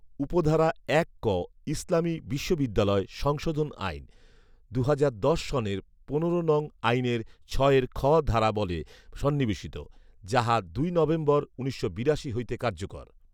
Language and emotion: Bengali, neutral